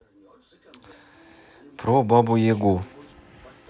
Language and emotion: Russian, neutral